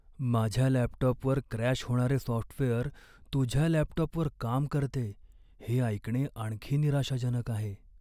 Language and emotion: Marathi, sad